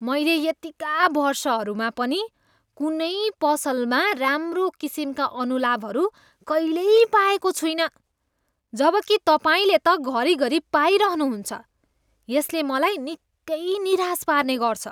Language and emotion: Nepali, disgusted